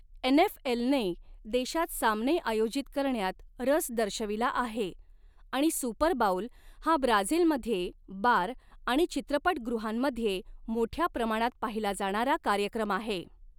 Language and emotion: Marathi, neutral